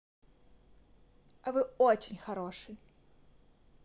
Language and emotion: Russian, positive